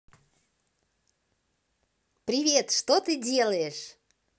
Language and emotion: Russian, positive